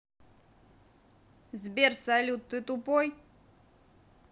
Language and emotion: Russian, neutral